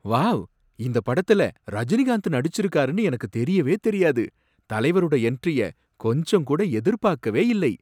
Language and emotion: Tamil, surprised